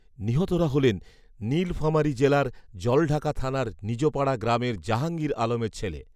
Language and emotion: Bengali, neutral